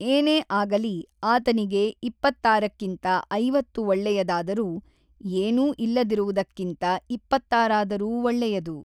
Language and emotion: Kannada, neutral